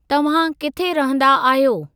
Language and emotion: Sindhi, neutral